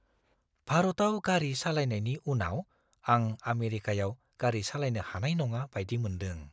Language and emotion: Bodo, fearful